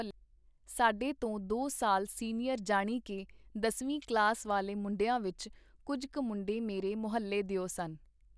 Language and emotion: Punjabi, neutral